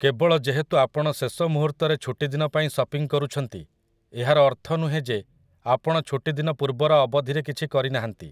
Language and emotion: Odia, neutral